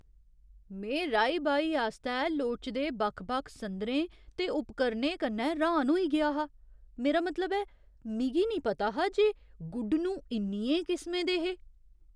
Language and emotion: Dogri, surprised